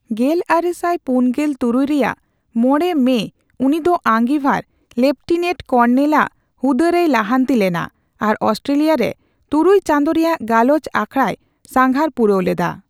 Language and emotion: Santali, neutral